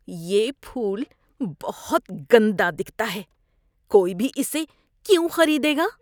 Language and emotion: Urdu, disgusted